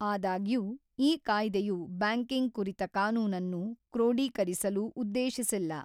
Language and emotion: Kannada, neutral